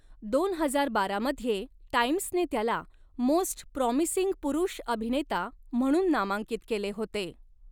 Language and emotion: Marathi, neutral